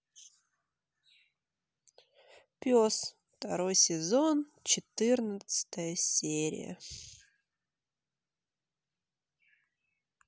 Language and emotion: Russian, sad